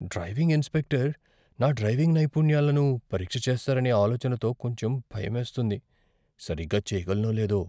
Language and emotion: Telugu, fearful